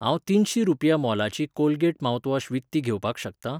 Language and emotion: Goan Konkani, neutral